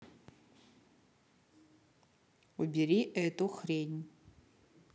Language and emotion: Russian, neutral